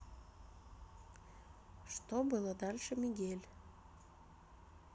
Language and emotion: Russian, neutral